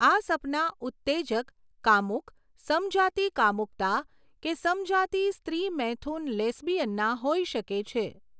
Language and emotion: Gujarati, neutral